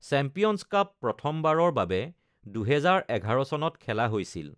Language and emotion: Assamese, neutral